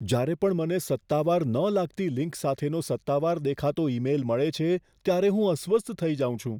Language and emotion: Gujarati, fearful